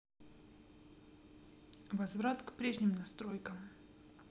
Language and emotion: Russian, neutral